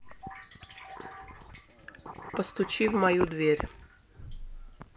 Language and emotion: Russian, neutral